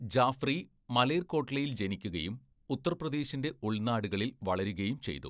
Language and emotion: Malayalam, neutral